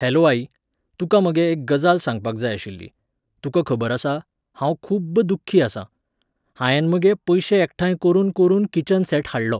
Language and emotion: Goan Konkani, neutral